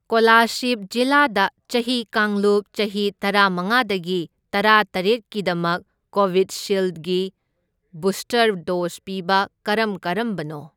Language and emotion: Manipuri, neutral